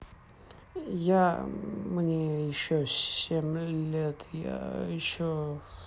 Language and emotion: Russian, neutral